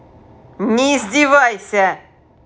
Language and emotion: Russian, angry